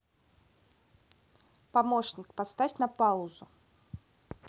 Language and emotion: Russian, neutral